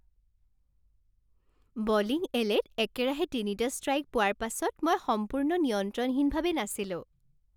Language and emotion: Assamese, happy